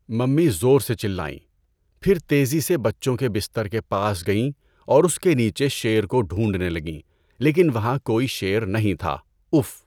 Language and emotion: Urdu, neutral